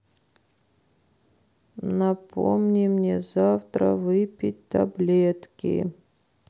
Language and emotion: Russian, sad